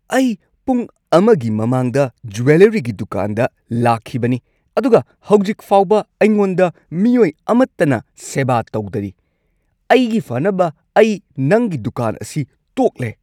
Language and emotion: Manipuri, angry